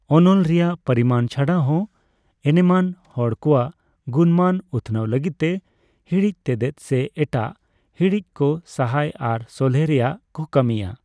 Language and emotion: Santali, neutral